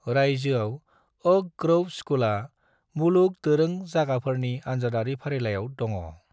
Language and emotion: Bodo, neutral